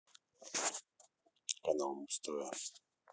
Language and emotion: Russian, neutral